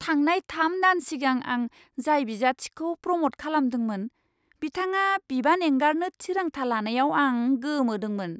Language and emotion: Bodo, surprised